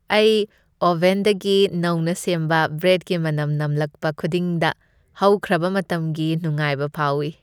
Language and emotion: Manipuri, happy